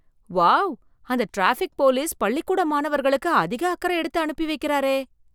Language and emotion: Tamil, surprised